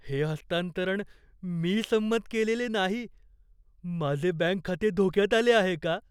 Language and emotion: Marathi, fearful